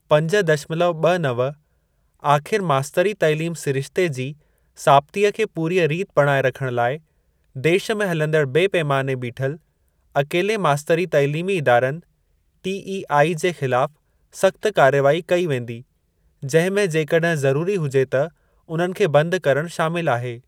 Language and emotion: Sindhi, neutral